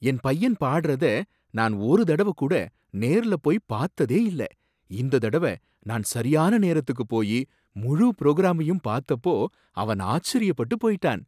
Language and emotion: Tamil, surprised